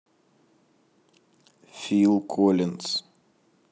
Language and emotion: Russian, neutral